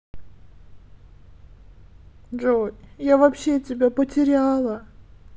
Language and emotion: Russian, sad